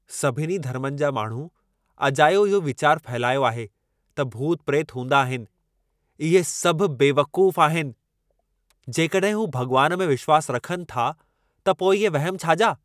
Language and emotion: Sindhi, angry